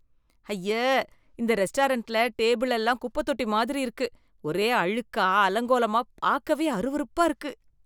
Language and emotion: Tamil, disgusted